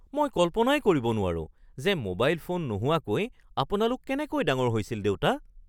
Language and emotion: Assamese, surprised